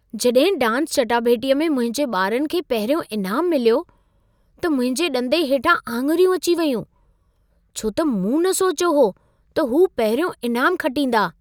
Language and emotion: Sindhi, surprised